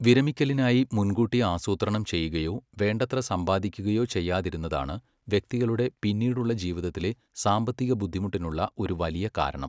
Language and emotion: Malayalam, neutral